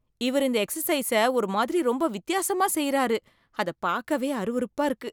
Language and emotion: Tamil, disgusted